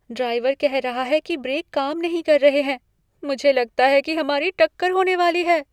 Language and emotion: Hindi, fearful